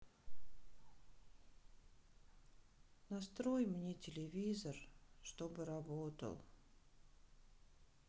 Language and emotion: Russian, sad